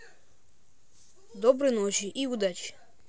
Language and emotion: Russian, neutral